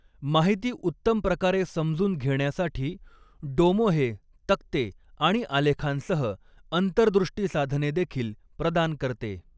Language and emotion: Marathi, neutral